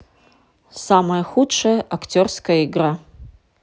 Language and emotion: Russian, neutral